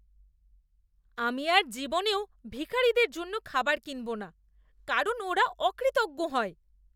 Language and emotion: Bengali, disgusted